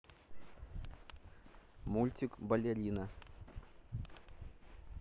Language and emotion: Russian, neutral